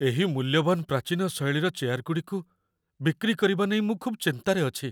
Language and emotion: Odia, fearful